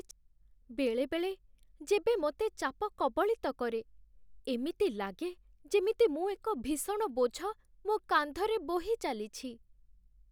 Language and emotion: Odia, sad